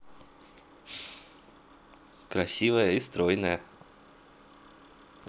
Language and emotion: Russian, positive